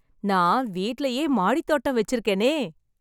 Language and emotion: Tamil, happy